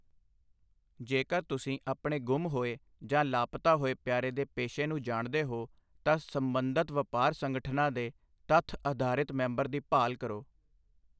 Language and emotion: Punjabi, neutral